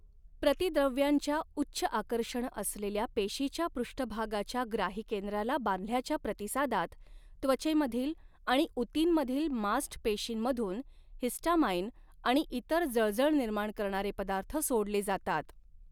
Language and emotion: Marathi, neutral